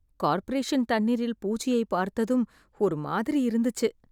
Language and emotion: Tamil, disgusted